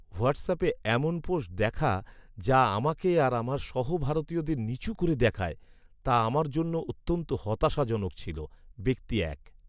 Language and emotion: Bengali, sad